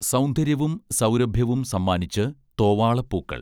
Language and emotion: Malayalam, neutral